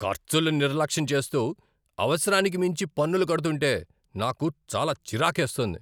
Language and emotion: Telugu, angry